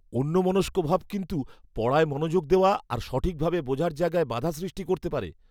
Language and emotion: Bengali, fearful